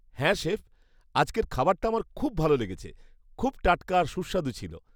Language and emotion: Bengali, happy